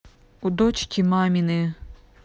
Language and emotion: Russian, neutral